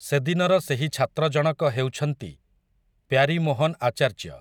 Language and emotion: Odia, neutral